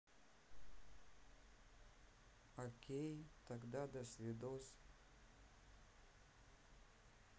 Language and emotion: Russian, neutral